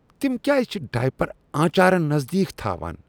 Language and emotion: Kashmiri, disgusted